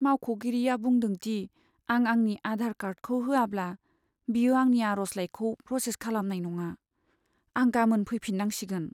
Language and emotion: Bodo, sad